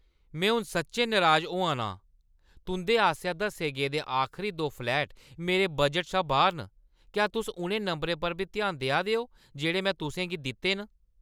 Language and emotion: Dogri, angry